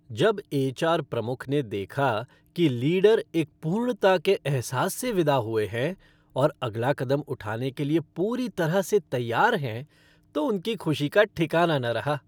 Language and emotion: Hindi, happy